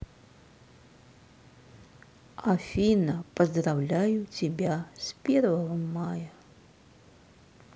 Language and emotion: Russian, sad